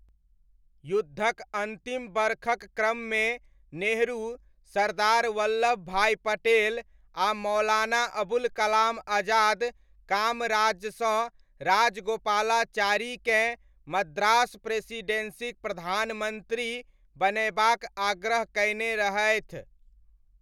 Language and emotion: Maithili, neutral